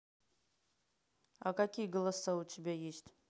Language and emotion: Russian, neutral